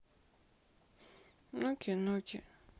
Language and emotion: Russian, sad